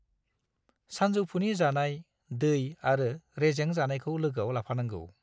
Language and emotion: Bodo, neutral